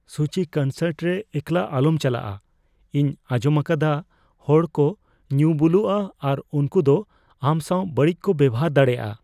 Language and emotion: Santali, fearful